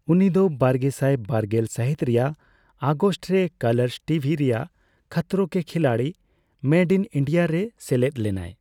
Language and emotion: Santali, neutral